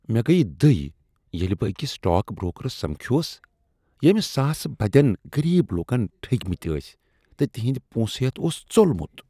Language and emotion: Kashmiri, disgusted